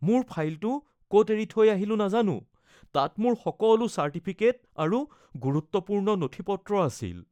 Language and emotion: Assamese, fearful